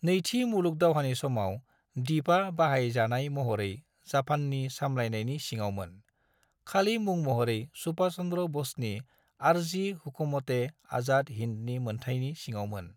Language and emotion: Bodo, neutral